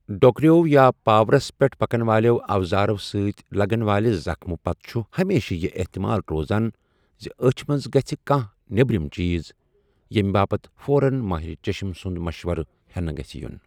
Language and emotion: Kashmiri, neutral